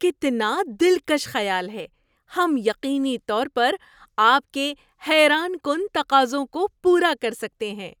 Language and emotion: Urdu, surprised